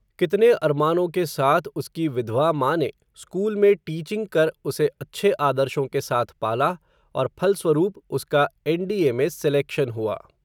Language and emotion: Hindi, neutral